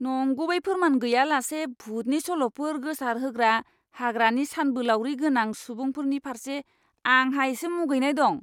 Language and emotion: Bodo, disgusted